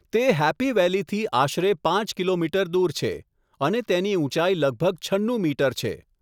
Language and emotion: Gujarati, neutral